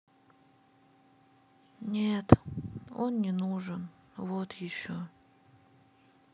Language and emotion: Russian, sad